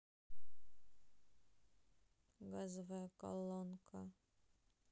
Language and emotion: Russian, sad